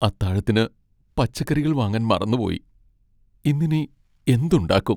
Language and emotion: Malayalam, sad